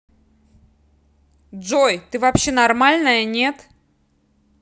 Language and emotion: Russian, angry